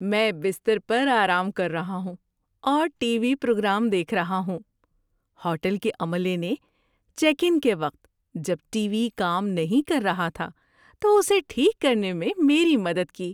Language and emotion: Urdu, happy